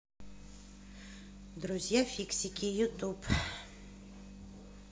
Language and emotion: Russian, neutral